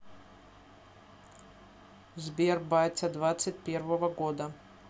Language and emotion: Russian, neutral